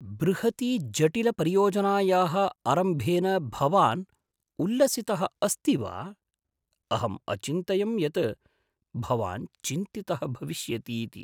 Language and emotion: Sanskrit, surprised